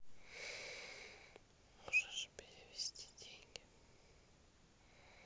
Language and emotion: Russian, neutral